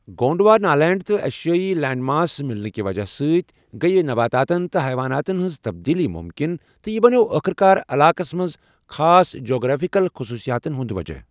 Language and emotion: Kashmiri, neutral